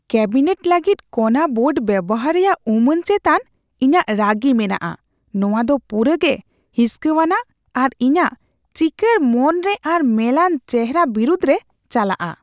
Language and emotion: Santali, disgusted